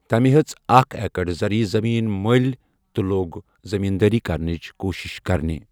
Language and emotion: Kashmiri, neutral